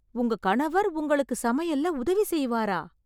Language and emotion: Tamil, surprised